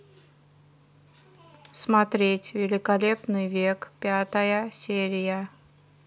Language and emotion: Russian, neutral